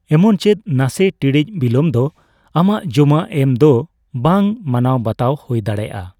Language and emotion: Santali, neutral